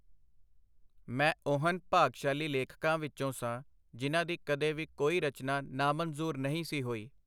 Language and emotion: Punjabi, neutral